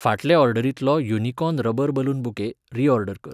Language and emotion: Goan Konkani, neutral